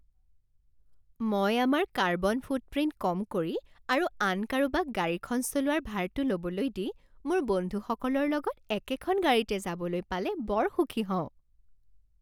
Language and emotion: Assamese, happy